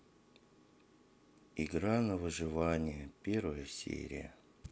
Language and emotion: Russian, sad